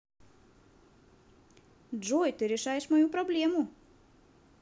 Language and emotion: Russian, positive